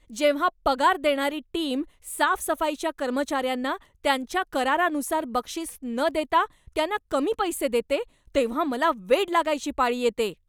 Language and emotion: Marathi, angry